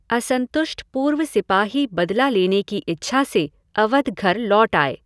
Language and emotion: Hindi, neutral